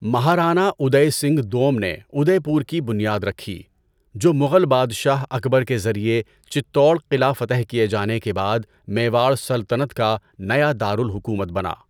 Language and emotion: Urdu, neutral